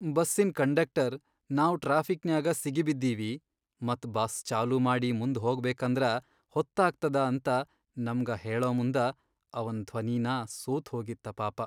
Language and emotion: Kannada, sad